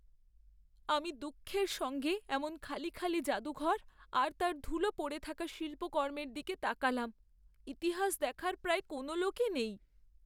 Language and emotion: Bengali, sad